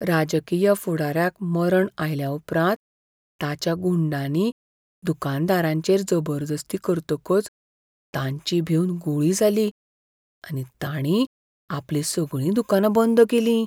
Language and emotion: Goan Konkani, fearful